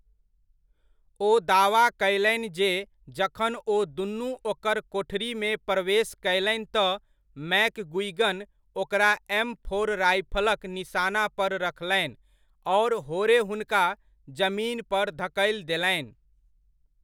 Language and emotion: Maithili, neutral